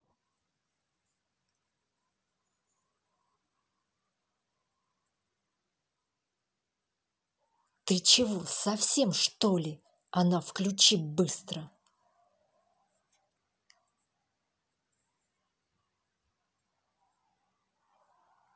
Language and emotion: Russian, angry